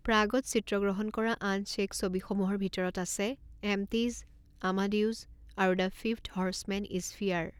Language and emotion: Assamese, neutral